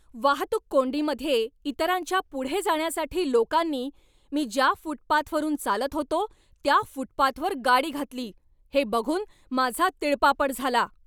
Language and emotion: Marathi, angry